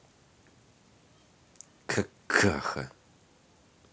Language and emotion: Russian, angry